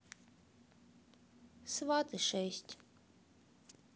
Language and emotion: Russian, sad